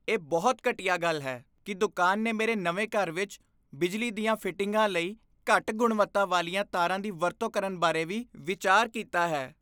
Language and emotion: Punjabi, disgusted